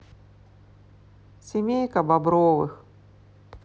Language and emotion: Russian, sad